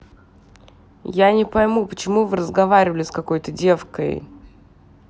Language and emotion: Russian, angry